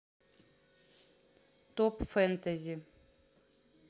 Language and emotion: Russian, neutral